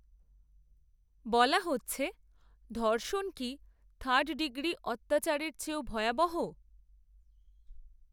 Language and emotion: Bengali, neutral